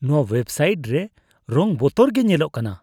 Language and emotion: Santali, disgusted